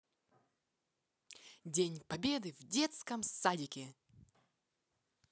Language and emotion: Russian, positive